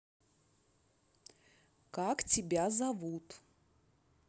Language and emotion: Russian, neutral